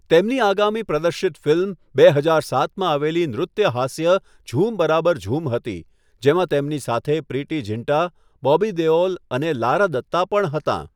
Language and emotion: Gujarati, neutral